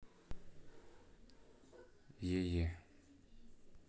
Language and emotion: Russian, neutral